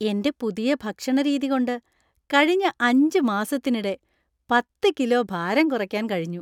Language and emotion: Malayalam, happy